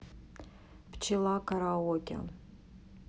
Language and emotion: Russian, neutral